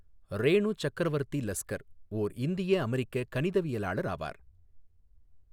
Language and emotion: Tamil, neutral